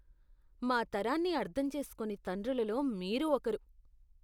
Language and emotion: Telugu, disgusted